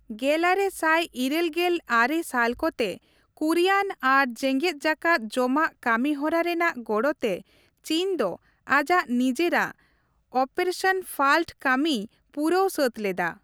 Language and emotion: Santali, neutral